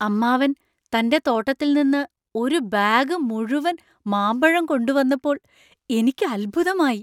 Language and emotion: Malayalam, surprised